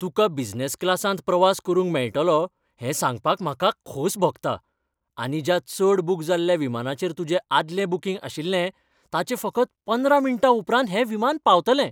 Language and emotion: Goan Konkani, happy